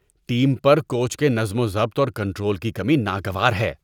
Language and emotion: Urdu, disgusted